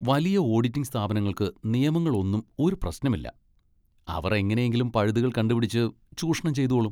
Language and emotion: Malayalam, disgusted